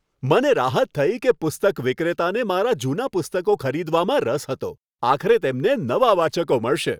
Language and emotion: Gujarati, happy